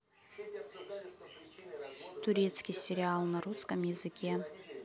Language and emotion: Russian, neutral